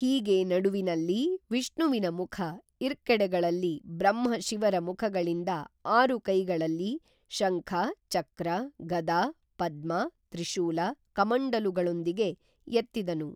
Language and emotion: Kannada, neutral